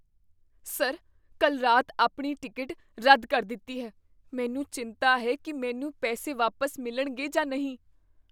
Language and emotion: Punjabi, fearful